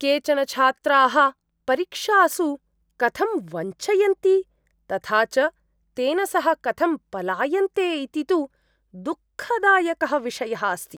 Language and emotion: Sanskrit, disgusted